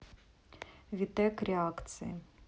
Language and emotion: Russian, neutral